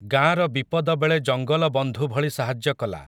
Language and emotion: Odia, neutral